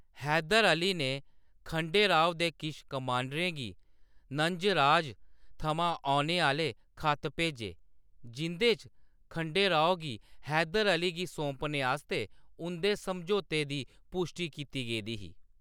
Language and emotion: Dogri, neutral